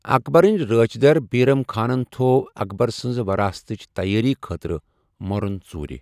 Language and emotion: Kashmiri, neutral